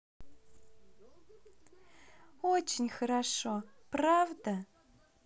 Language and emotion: Russian, positive